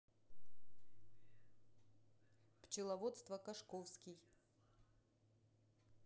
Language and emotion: Russian, neutral